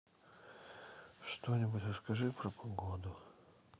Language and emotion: Russian, sad